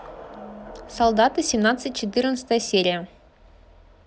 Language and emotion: Russian, neutral